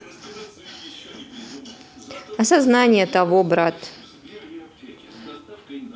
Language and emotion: Russian, neutral